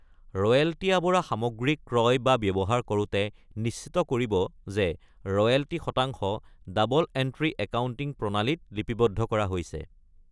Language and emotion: Assamese, neutral